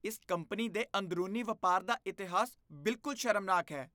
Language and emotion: Punjabi, disgusted